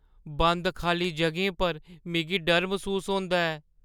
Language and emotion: Dogri, fearful